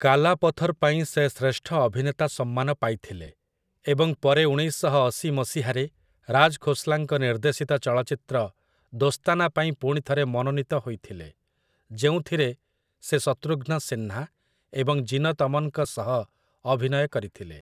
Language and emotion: Odia, neutral